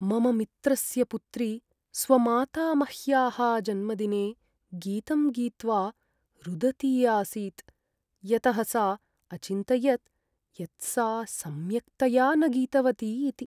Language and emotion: Sanskrit, sad